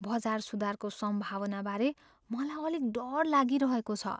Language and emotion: Nepali, fearful